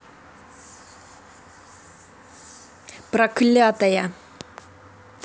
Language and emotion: Russian, angry